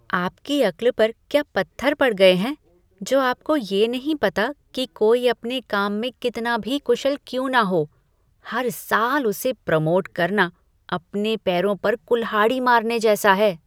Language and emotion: Hindi, disgusted